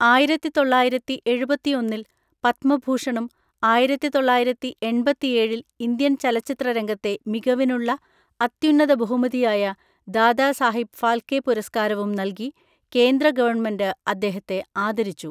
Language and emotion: Malayalam, neutral